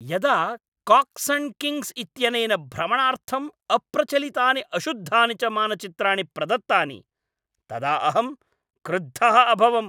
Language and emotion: Sanskrit, angry